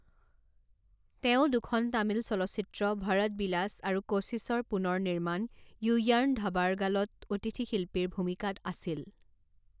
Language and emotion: Assamese, neutral